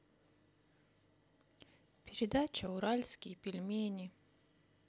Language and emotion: Russian, sad